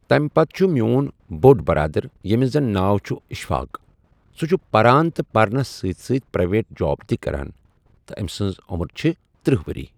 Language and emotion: Kashmiri, neutral